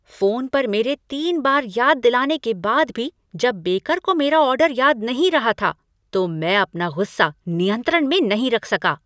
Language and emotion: Hindi, angry